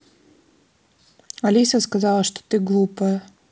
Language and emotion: Russian, neutral